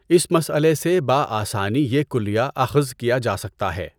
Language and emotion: Urdu, neutral